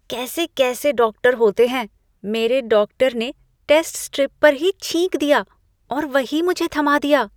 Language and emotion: Hindi, disgusted